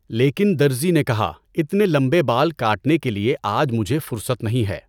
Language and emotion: Urdu, neutral